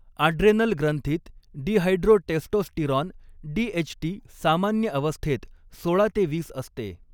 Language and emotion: Marathi, neutral